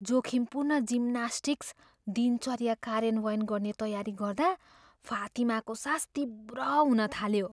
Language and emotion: Nepali, fearful